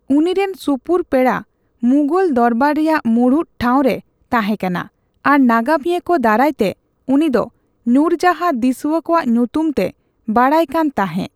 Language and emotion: Santali, neutral